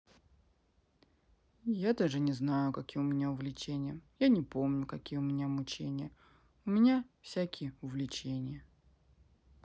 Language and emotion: Russian, sad